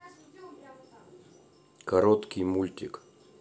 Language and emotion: Russian, neutral